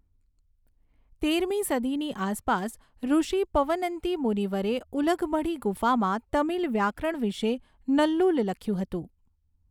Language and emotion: Gujarati, neutral